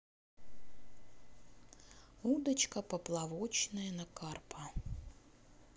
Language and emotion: Russian, neutral